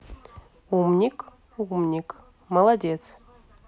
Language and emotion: Russian, neutral